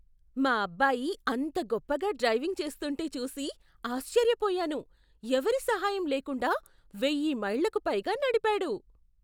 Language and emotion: Telugu, surprised